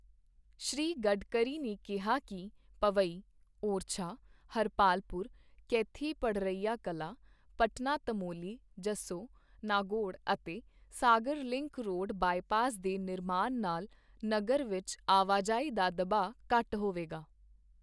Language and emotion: Punjabi, neutral